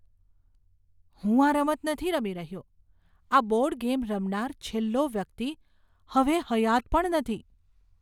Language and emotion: Gujarati, fearful